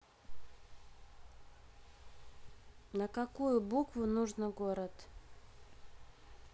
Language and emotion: Russian, neutral